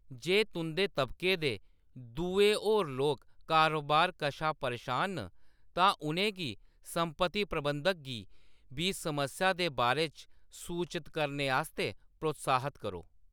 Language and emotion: Dogri, neutral